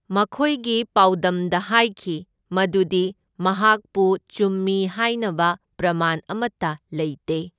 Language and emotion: Manipuri, neutral